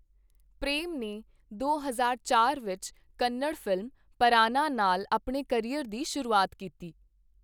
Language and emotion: Punjabi, neutral